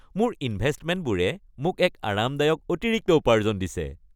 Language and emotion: Assamese, happy